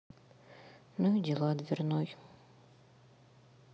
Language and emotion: Russian, sad